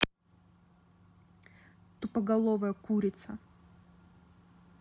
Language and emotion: Russian, angry